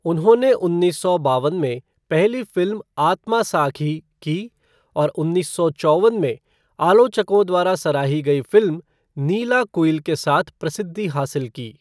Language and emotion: Hindi, neutral